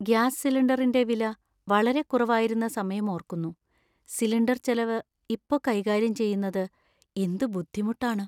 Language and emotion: Malayalam, sad